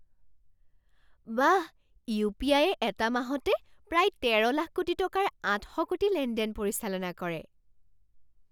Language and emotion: Assamese, surprised